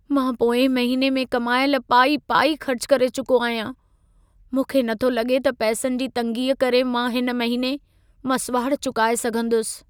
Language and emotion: Sindhi, sad